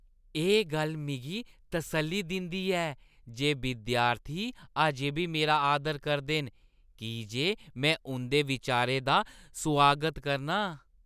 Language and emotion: Dogri, happy